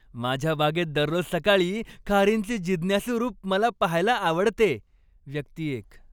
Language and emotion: Marathi, happy